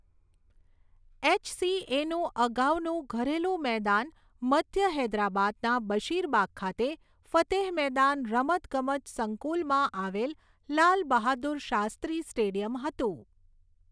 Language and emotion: Gujarati, neutral